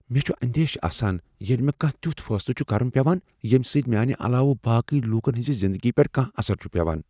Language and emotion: Kashmiri, fearful